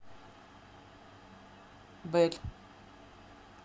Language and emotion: Russian, neutral